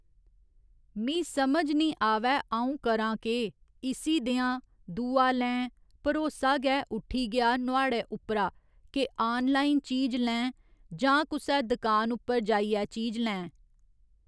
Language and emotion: Dogri, neutral